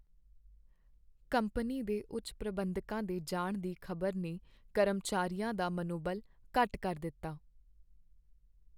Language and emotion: Punjabi, sad